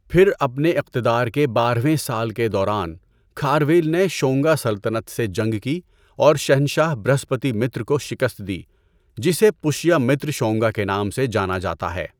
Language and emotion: Urdu, neutral